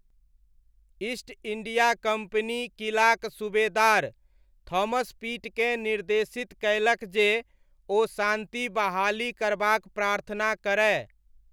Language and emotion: Maithili, neutral